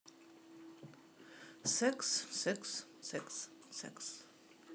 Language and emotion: Russian, neutral